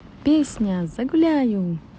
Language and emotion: Russian, positive